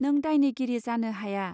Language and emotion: Bodo, neutral